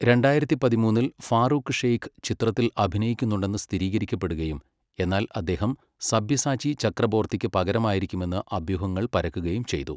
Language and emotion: Malayalam, neutral